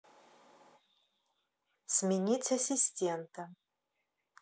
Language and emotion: Russian, neutral